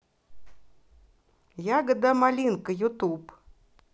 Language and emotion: Russian, positive